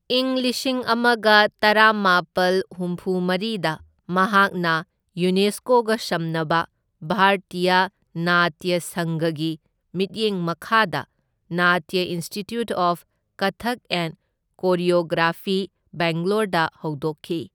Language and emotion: Manipuri, neutral